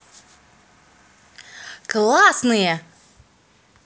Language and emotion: Russian, positive